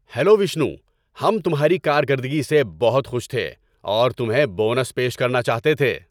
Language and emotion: Urdu, happy